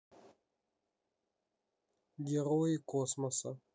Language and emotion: Russian, neutral